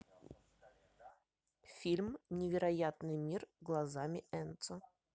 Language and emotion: Russian, neutral